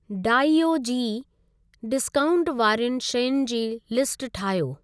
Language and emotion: Sindhi, neutral